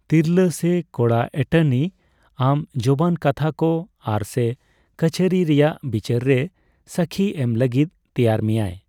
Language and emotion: Santali, neutral